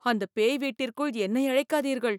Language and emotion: Tamil, fearful